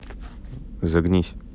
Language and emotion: Russian, neutral